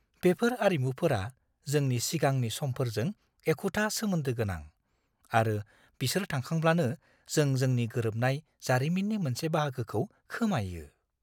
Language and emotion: Bodo, fearful